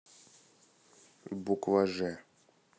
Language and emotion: Russian, neutral